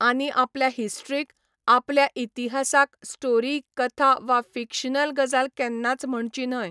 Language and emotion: Goan Konkani, neutral